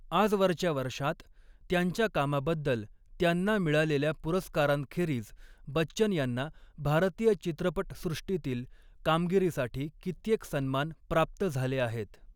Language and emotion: Marathi, neutral